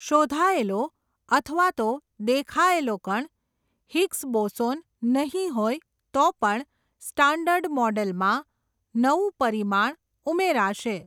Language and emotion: Gujarati, neutral